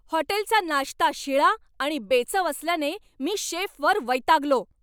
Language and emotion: Marathi, angry